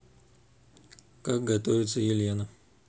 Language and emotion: Russian, neutral